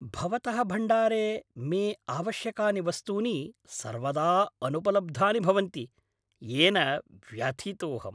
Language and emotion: Sanskrit, angry